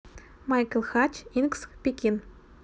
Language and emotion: Russian, neutral